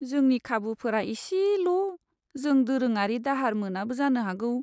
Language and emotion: Bodo, sad